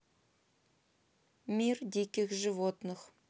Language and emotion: Russian, neutral